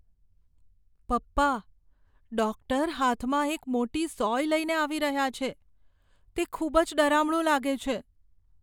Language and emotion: Gujarati, fearful